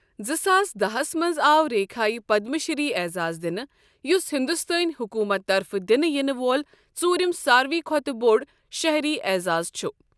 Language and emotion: Kashmiri, neutral